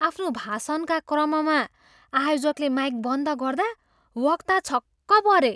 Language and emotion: Nepali, surprised